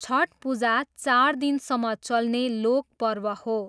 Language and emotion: Nepali, neutral